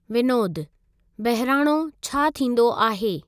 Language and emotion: Sindhi, neutral